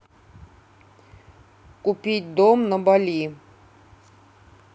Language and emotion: Russian, neutral